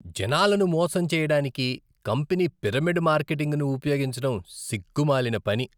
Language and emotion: Telugu, disgusted